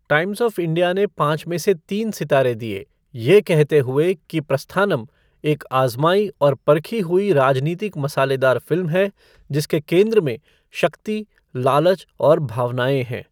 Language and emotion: Hindi, neutral